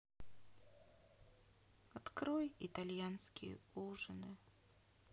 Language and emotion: Russian, sad